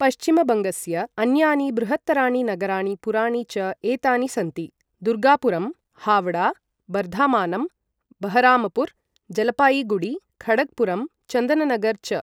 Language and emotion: Sanskrit, neutral